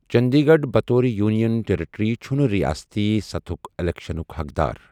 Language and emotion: Kashmiri, neutral